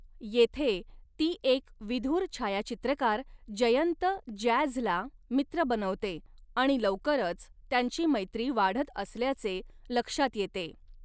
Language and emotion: Marathi, neutral